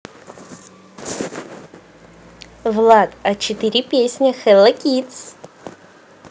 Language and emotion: Russian, positive